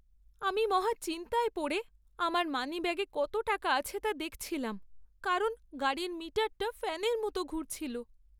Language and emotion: Bengali, sad